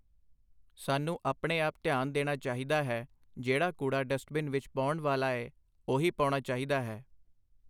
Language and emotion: Punjabi, neutral